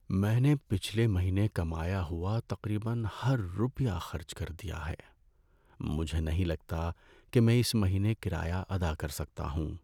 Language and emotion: Urdu, sad